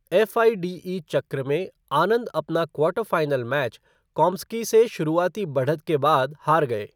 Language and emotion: Hindi, neutral